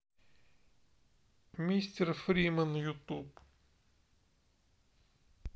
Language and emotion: Russian, sad